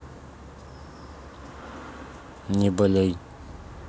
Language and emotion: Russian, neutral